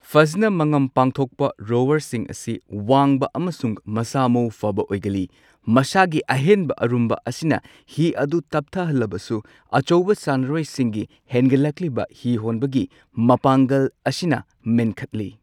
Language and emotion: Manipuri, neutral